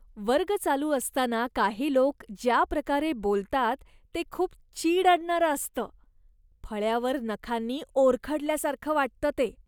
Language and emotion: Marathi, disgusted